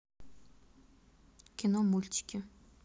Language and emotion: Russian, neutral